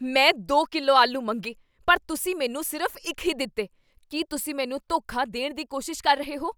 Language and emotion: Punjabi, angry